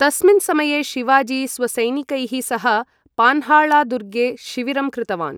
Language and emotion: Sanskrit, neutral